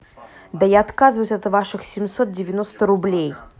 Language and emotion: Russian, angry